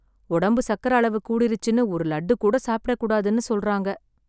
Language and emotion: Tamil, sad